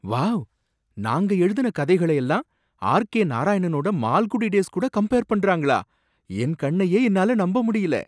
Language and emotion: Tamil, surprised